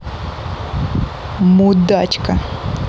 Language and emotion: Russian, angry